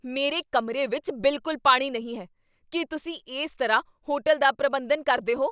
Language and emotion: Punjabi, angry